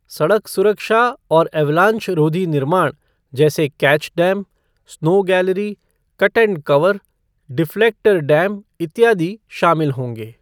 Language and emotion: Hindi, neutral